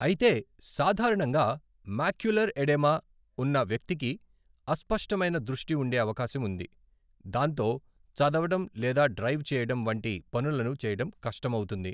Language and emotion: Telugu, neutral